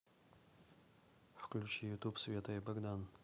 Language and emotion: Russian, neutral